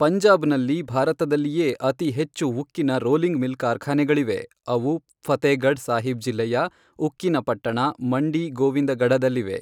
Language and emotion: Kannada, neutral